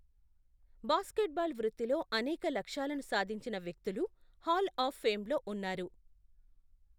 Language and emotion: Telugu, neutral